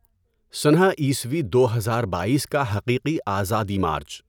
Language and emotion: Urdu, neutral